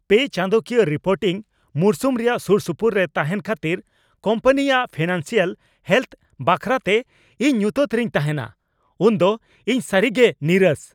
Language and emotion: Santali, angry